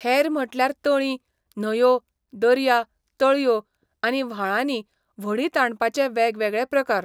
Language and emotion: Goan Konkani, neutral